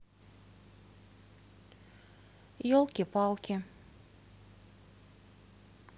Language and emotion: Russian, neutral